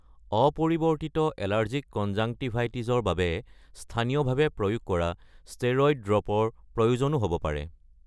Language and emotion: Assamese, neutral